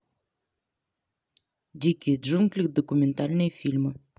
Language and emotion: Russian, neutral